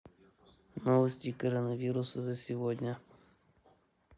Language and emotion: Russian, neutral